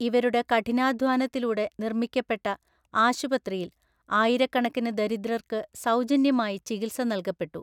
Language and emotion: Malayalam, neutral